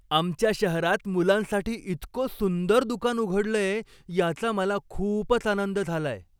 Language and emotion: Marathi, happy